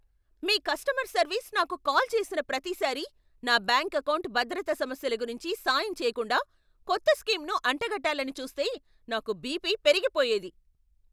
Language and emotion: Telugu, angry